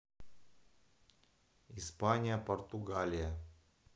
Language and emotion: Russian, neutral